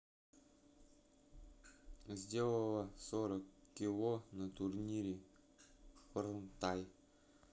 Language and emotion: Russian, neutral